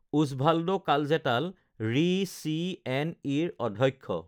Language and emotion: Assamese, neutral